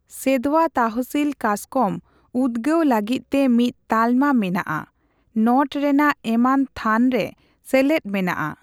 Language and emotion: Santali, neutral